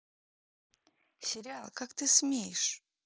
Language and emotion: Russian, angry